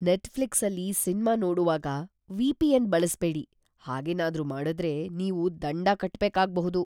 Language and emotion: Kannada, fearful